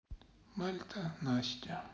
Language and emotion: Russian, sad